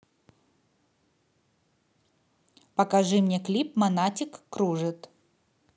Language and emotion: Russian, neutral